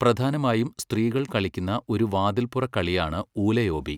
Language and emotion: Malayalam, neutral